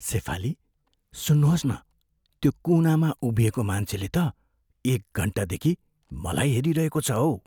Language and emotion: Nepali, fearful